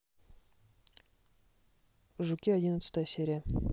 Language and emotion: Russian, neutral